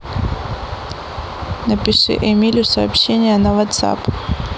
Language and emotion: Russian, neutral